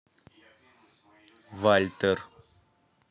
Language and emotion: Russian, neutral